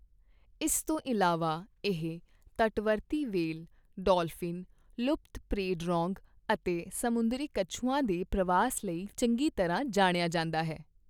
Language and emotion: Punjabi, neutral